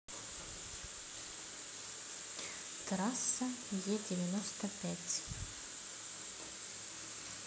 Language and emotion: Russian, neutral